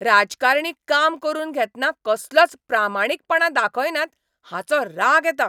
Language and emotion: Goan Konkani, angry